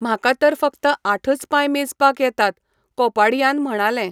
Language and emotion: Goan Konkani, neutral